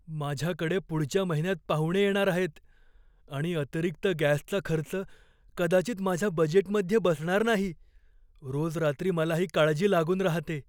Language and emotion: Marathi, fearful